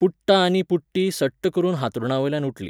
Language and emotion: Goan Konkani, neutral